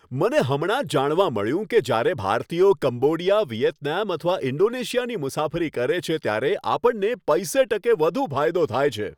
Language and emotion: Gujarati, happy